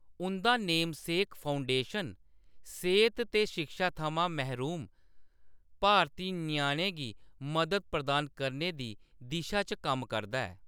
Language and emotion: Dogri, neutral